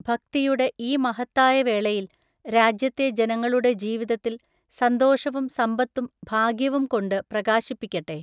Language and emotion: Malayalam, neutral